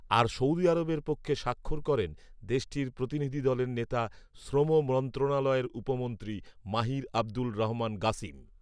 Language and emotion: Bengali, neutral